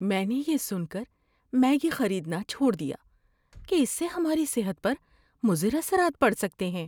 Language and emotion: Urdu, fearful